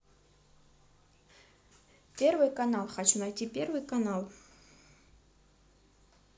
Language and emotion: Russian, neutral